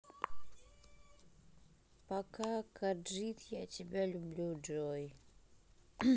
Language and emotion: Russian, neutral